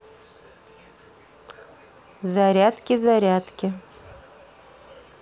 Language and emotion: Russian, neutral